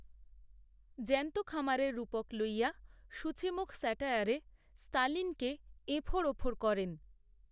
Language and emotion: Bengali, neutral